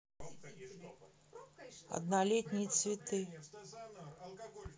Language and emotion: Russian, neutral